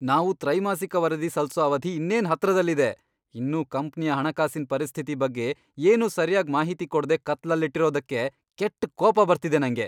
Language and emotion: Kannada, angry